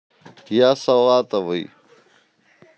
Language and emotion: Russian, neutral